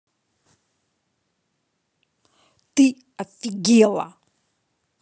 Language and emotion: Russian, angry